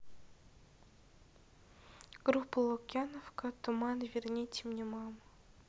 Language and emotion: Russian, neutral